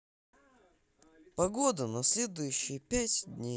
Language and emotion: Russian, neutral